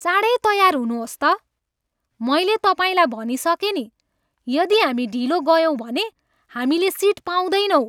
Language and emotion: Nepali, angry